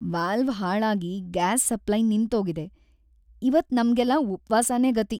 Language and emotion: Kannada, sad